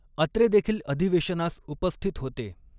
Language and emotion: Marathi, neutral